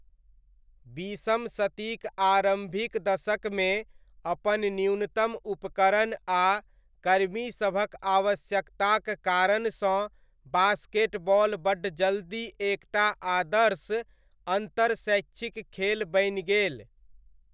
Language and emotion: Maithili, neutral